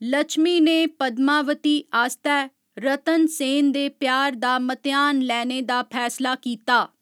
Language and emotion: Dogri, neutral